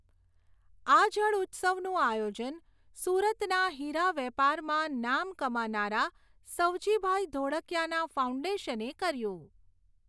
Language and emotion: Gujarati, neutral